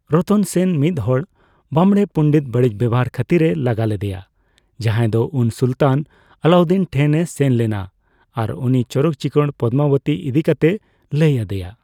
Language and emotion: Santali, neutral